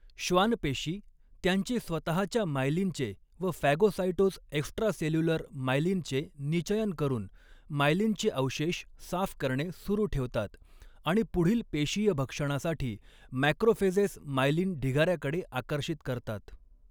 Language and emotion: Marathi, neutral